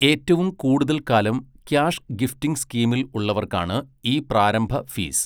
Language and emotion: Malayalam, neutral